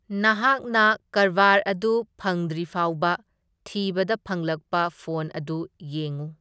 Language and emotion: Manipuri, neutral